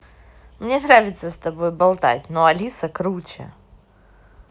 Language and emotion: Russian, positive